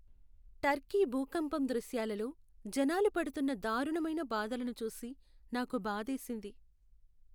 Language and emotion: Telugu, sad